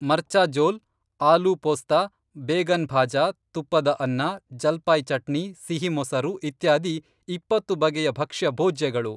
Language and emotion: Kannada, neutral